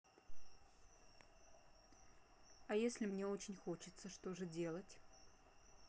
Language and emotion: Russian, neutral